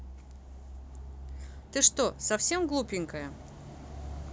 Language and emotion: Russian, neutral